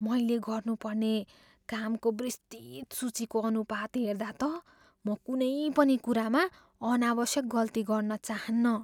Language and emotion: Nepali, fearful